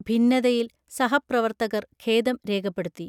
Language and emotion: Malayalam, neutral